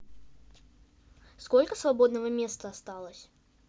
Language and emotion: Russian, neutral